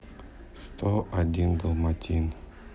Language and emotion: Russian, sad